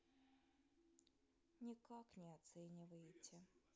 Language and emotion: Russian, sad